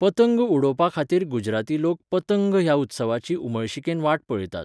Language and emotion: Goan Konkani, neutral